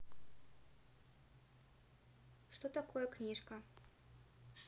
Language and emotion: Russian, neutral